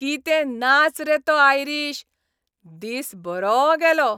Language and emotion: Goan Konkani, happy